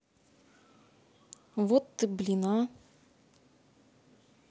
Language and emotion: Russian, angry